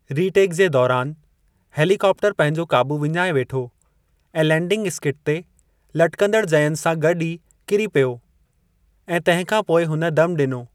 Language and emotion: Sindhi, neutral